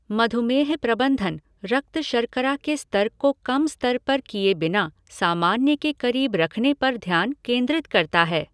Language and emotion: Hindi, neutral